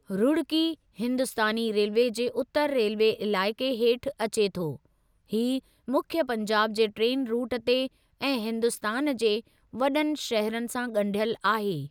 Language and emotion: Sindhi, neutral